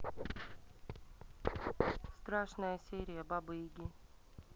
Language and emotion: Russian, neutral